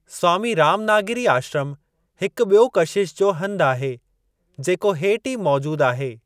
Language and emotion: Sindhi, neutral